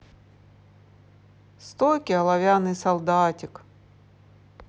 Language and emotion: Russian, neutral